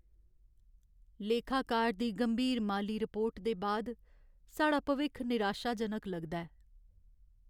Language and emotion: Dogri, sad